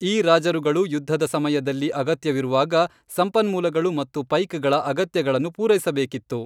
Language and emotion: Kannada, neutral